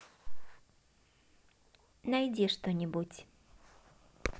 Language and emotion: Russian, positive